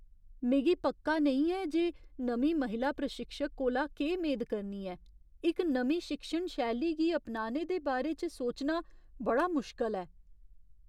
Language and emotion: Dogri, fearful